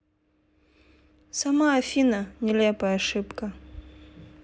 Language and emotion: Russian, neutral